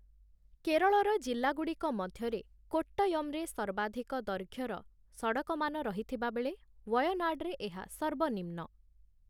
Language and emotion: Odia, neutral